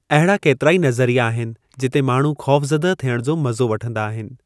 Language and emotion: Sindhi, neutral